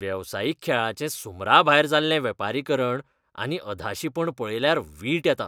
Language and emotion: Goan Konkani, disgusted